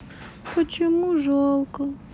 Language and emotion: Russian, sad